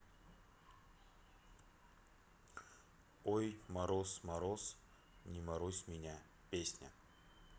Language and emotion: Russian, neutral